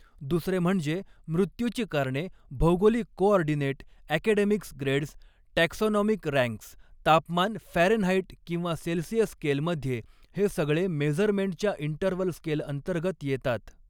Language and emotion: Marathi, neutral